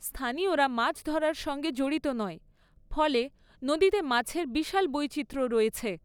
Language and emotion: Bengali, neutral